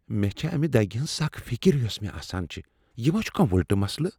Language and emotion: Kashmiri, fearful